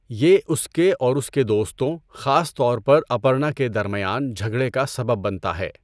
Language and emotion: Urdu, neutral